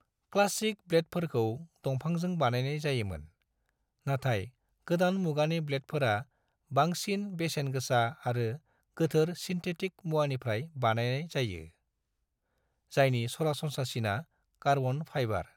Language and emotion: Bodo, neutral